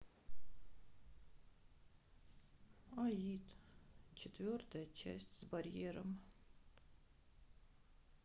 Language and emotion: Russian, sad